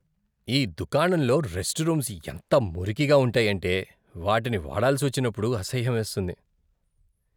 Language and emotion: Telugu, disgusted